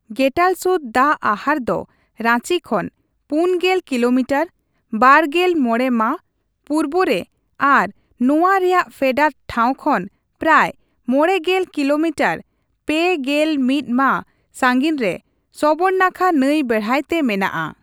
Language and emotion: Santali, neutral